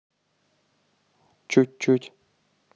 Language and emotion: Russian, neutral